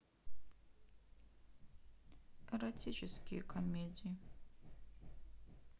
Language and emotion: Russian, sad